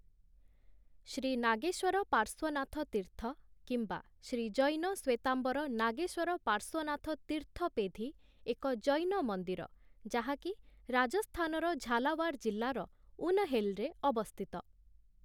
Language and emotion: Odia, neutral